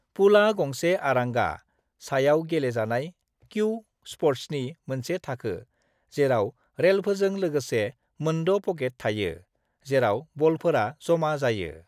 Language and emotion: Bodo, neutral